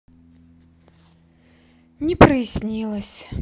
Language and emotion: Russian, sad